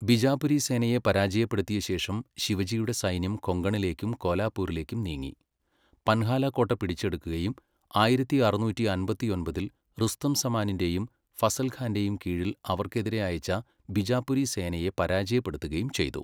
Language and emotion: Malayalam, neutral